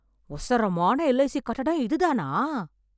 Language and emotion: Tamil, surprised